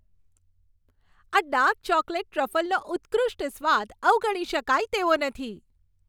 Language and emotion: Gujarati, happy